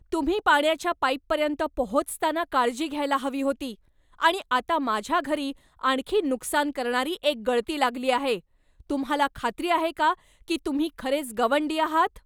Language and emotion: Marathi, angry